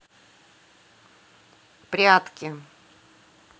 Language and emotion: Russian, neutral